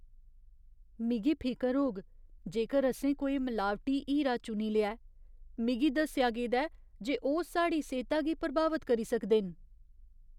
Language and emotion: Dogri, fearful